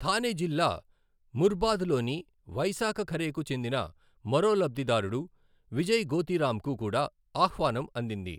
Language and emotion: Telugu, neutral